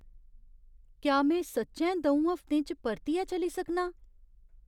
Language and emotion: Dogri, surprised